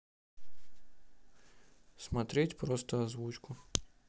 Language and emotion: Russian, neutral